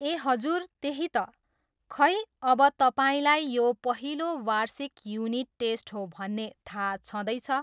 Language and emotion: Nepali, neutral